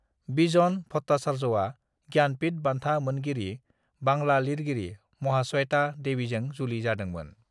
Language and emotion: Bodo, neutral